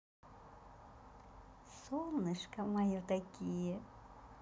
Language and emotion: Russian, positive